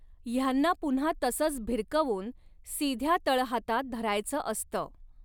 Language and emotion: Marathi, neutral